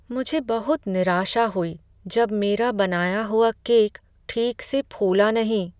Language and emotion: Hindi, sad